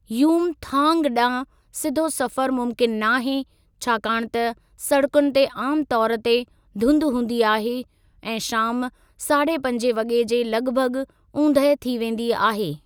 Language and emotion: Sindhi, neutral